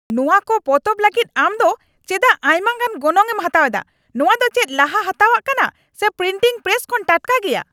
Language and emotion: Santali, angry